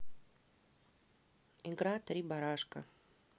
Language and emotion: Russian, neutral